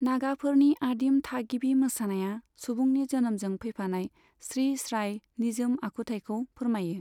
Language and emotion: Bodo, neutral